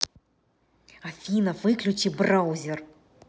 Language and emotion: Russian, angry